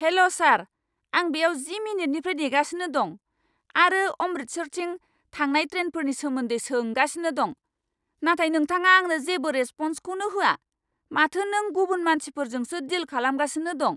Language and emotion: Bodo, angry